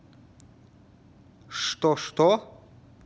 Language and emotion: Russian, angry